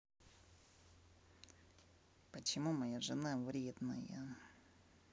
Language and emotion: Russian, neutral